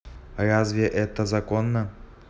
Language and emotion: Russian, neutral